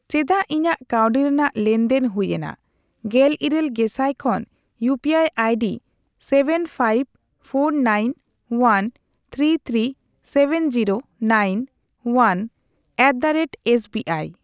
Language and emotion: Santali, neutral